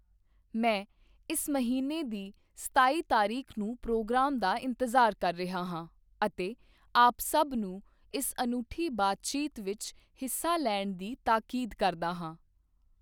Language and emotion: Punjabi, neutral